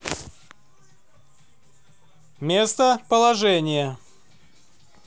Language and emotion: Russian, neutral